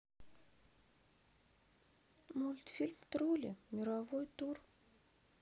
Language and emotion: Russian, sad